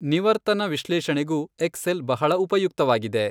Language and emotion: Kannada, neutral